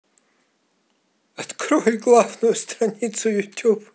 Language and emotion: Russian, positive